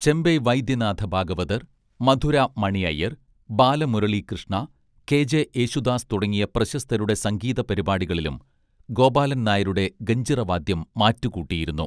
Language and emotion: Malayalam, neutral